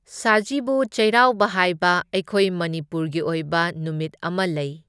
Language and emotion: Manipuri, neutral